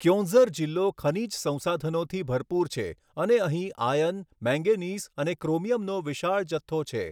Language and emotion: Gujarati, neutral